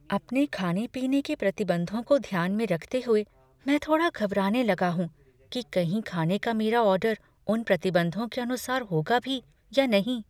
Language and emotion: Hindi, fearful